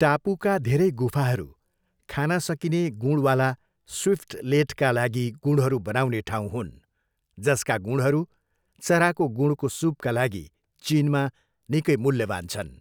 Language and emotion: Nepali, neutral